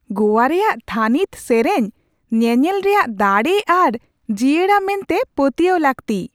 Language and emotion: Santali, surprised